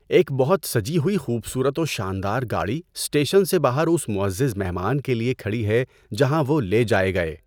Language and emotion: Urdu, neutral